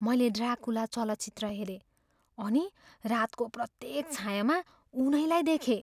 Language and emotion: Nepali, fearful